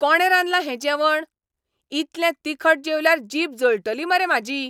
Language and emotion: Goan Konkani, angry